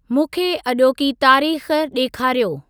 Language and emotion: Sindhi, neutral